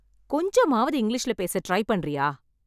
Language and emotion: Tamil, angry